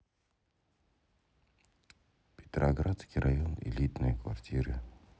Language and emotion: Russian, neutral